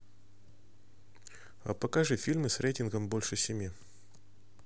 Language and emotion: Russian, neutral